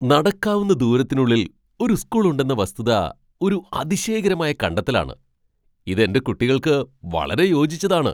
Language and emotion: Malayalam, surprised